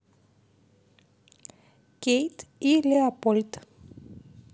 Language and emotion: Russian, neutral